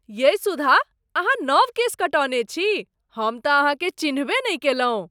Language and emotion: Maithili, surprised